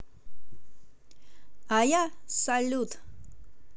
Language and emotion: Russian, positive